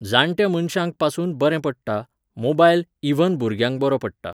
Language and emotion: Goan Konkani, neutral